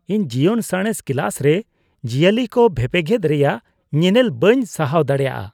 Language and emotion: Santali, disgusted